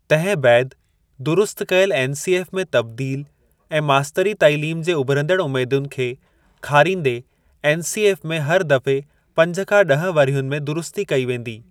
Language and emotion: Sindhi, neutral